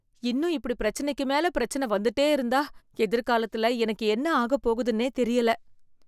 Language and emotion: Tamil, fearful